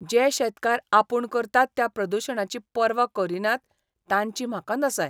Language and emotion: Goan Konkani, disgusted